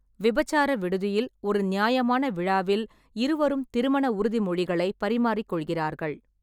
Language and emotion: Tamil, neutral